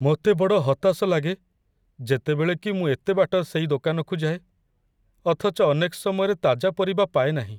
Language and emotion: Odia, sad